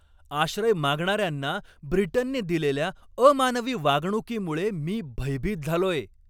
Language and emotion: Marathi, angry